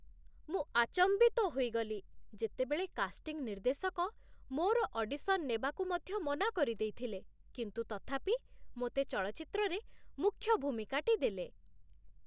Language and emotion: Odia, surprised